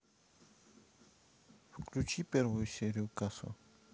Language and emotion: Russian, neutral